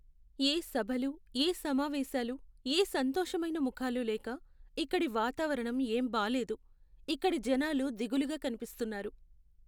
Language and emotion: Telugu, sad